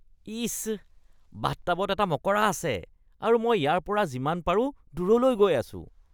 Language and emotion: Assamese, disgusted